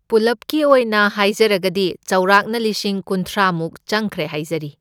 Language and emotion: Manipuri, neutral